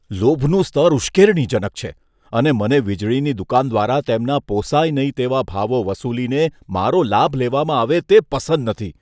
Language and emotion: Gujarati, disgusted